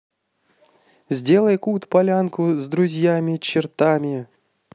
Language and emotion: Russian, positive